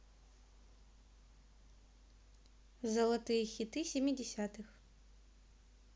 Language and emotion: Russian, neutral